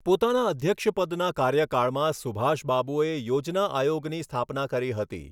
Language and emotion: Gujarati, neutral